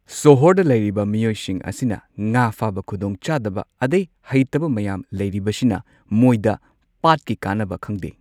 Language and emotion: Manipuri, neutral